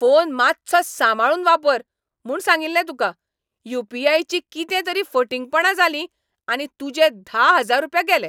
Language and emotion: Goan Konkani, angry